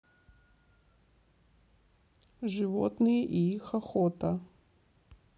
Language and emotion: Russian, neutral